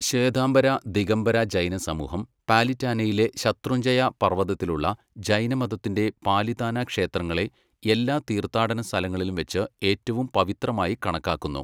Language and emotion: Malayalam, neutral